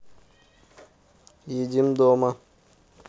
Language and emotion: Russian, neutral